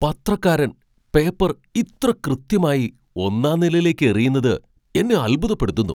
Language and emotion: Malayalam, surprised